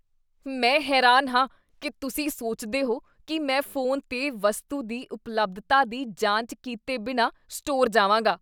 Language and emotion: Punjabi, disgusted